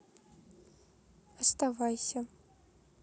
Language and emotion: Russian, neutral